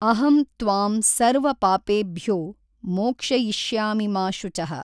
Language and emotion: Kannada, neutral